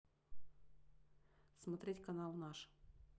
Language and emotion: Russian, neutral